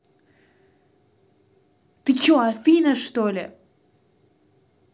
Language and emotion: Russian, angry